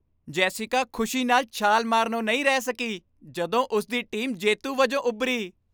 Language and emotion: Punjabi, happy